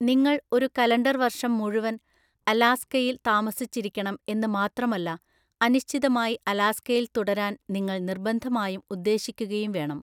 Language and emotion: Malayalam, neutral